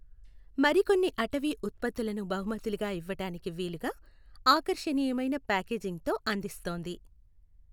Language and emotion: Telugu, neutral